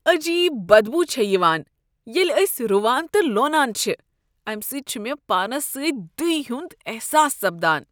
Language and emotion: Kashmiri, disgusted